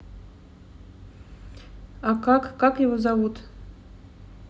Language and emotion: Russian, neutral